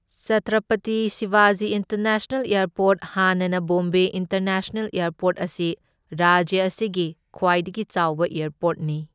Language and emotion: Manipuri, neutral